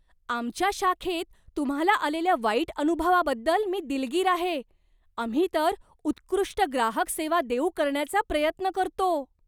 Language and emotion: Marathi, surprised